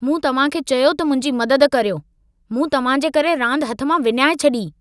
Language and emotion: Sindhi, angry